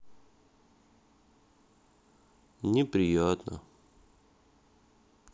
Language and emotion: Russian, sad